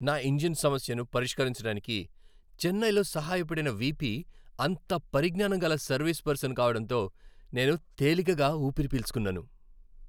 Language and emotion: Telugu, happy